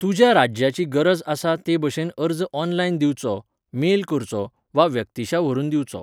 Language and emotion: Goan Konkani, neutral